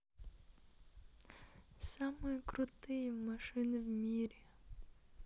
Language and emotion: Russian, positive